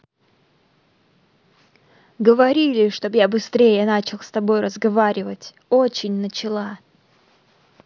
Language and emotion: Russian, angry